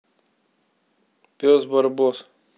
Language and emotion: Russian, neutral